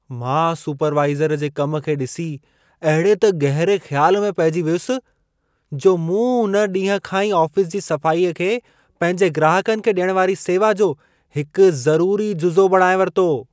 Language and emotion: Sindhi, surprised